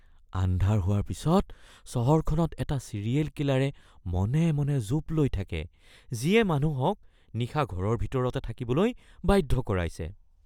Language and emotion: Assamese, fearful